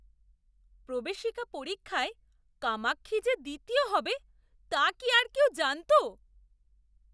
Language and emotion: Bengali, surprised